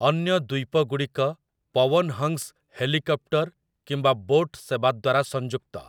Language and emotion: Odia, neutral